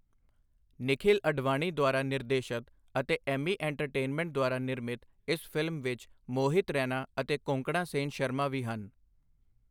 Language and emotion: Punjabi, neutral